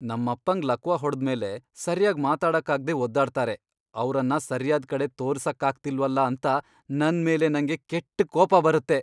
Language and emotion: Kannada, angry